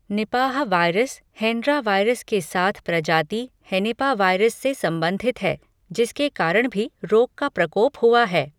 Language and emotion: Hindi, neutral